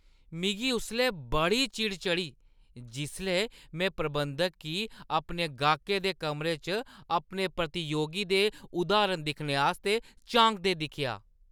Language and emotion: Dogri, disgusted